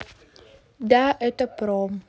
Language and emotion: Russian, neutral